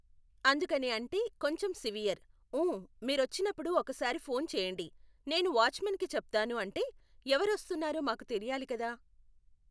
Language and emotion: Telugu, neutral